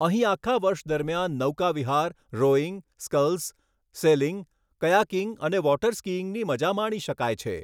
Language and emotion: Gujarati, neutral